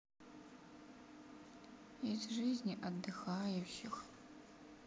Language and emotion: Russian, sad